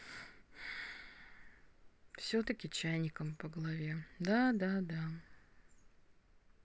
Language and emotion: Russian, sad